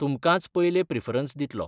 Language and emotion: Goan Konkani, neutral